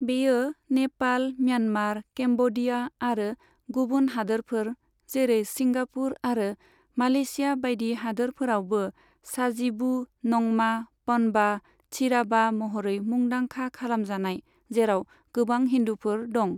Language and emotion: Bodo, neutral